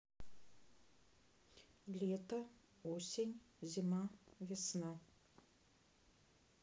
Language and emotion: Russian, neutral